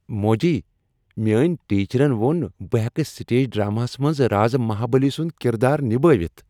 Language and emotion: Kashmiri, happy